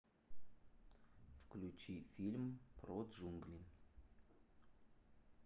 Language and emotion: Russian, neutral